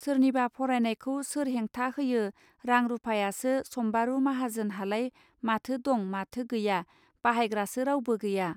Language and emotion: Bodo, neutral